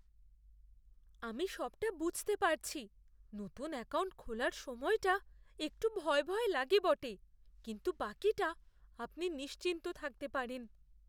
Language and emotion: Bengali, fearful